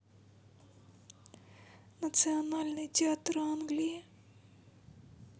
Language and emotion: Russian, sad